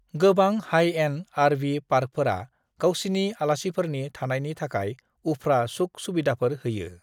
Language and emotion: Bodo, neutral